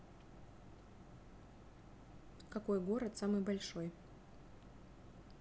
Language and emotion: Russian, neutral